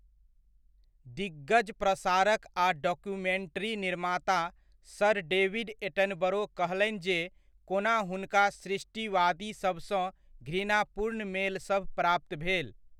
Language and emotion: Maithili, neutral